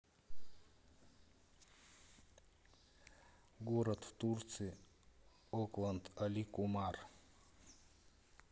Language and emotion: Russian, neutral